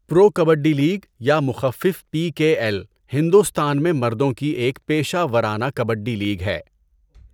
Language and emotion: Urdu, neutral